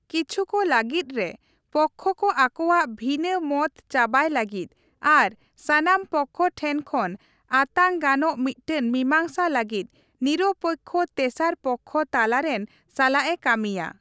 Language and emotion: Santali, neutral